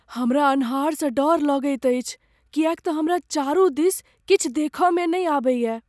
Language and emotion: Maithili, fearful